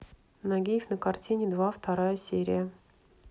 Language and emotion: Russian, neutral